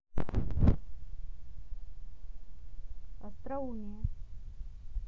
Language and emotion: Russian, neutral